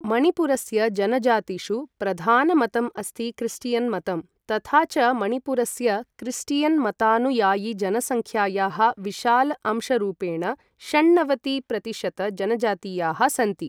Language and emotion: Sanskrit, neutral